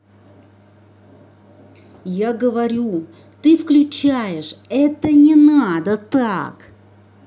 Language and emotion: Russian, angry